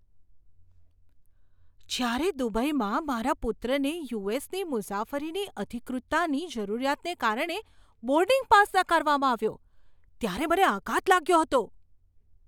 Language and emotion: Gujarati, surprised